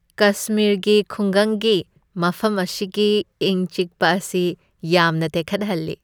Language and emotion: Manipuri, happy